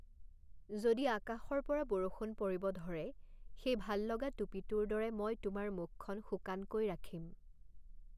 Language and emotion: Assamese, neutral